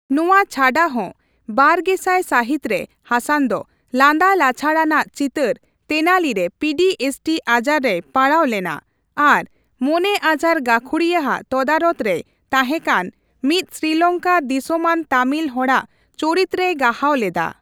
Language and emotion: Santali, neutral